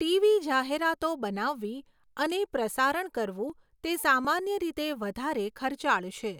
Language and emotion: Gujarati, neutral